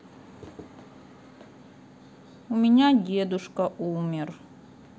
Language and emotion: Russian, sad